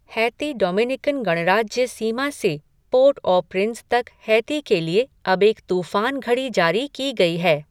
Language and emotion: Hindi, neutral